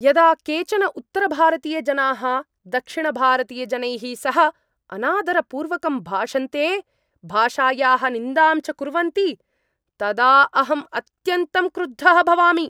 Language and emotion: Sanskrit, angry